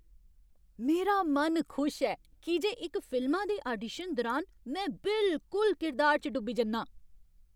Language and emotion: Dogri, happy